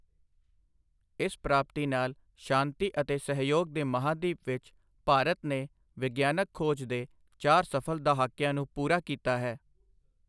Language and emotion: Punjabi, neutral